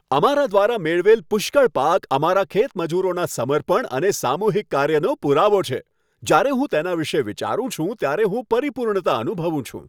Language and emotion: Gujarati, happy